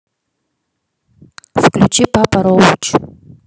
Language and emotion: Russian, neutral